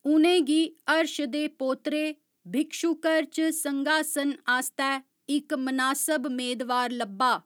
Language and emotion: Dogri, neutral